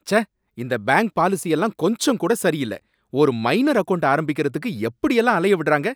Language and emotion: Tamil, angry